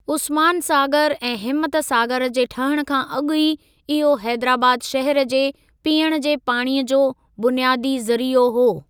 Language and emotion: Sindhi, neutral